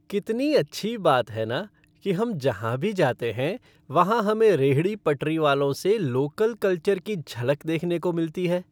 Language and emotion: Hindi, happy